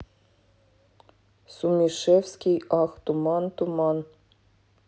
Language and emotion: Russian, neutral